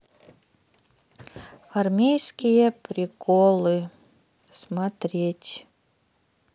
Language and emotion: Russian, sad